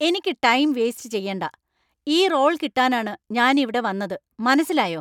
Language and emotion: Malayalam, angry